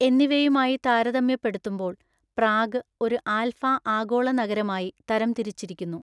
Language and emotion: Malayalam, neutral